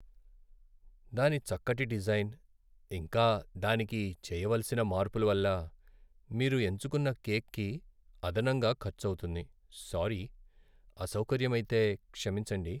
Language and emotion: Telugu, sad